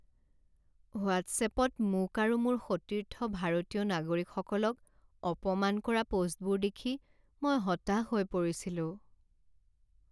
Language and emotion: Assamese, sad